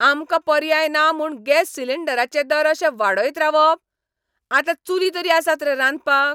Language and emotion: Goan Konkani, angry